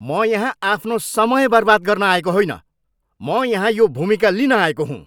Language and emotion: Nepali, angry